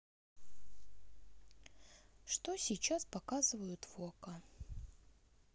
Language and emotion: Russian, neutral